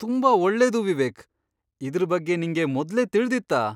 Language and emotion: Kannada, surprised